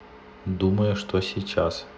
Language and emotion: Russian, neutral